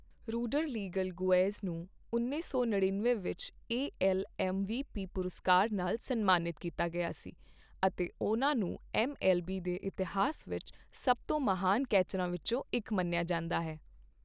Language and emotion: Punjabi, neutral